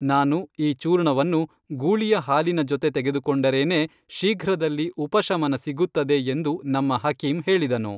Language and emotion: Kannada, neutral